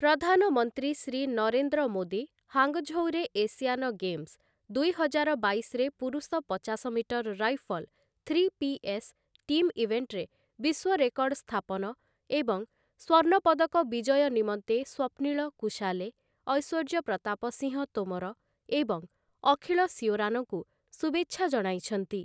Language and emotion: Odia, neutral